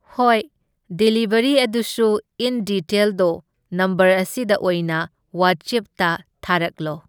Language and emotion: Manipuri, neutral